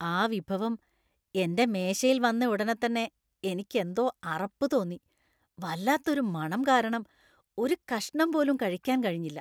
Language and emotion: Malayalam, disgusted